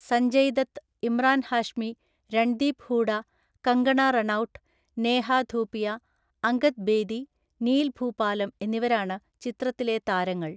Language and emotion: Malayalam, neutral